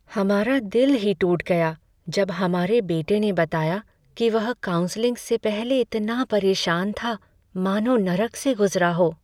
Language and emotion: Hindi, sad